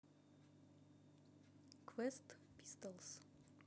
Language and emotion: Russian, neutral